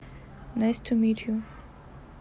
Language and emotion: Russian, neutral